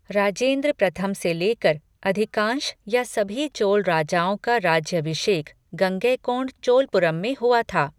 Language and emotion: Hindi, neutral